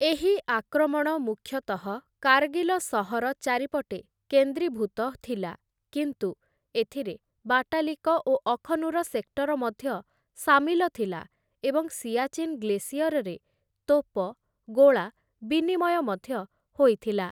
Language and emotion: Odia, neutral